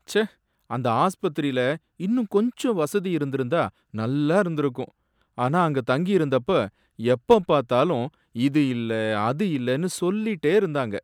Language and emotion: Tamil, sad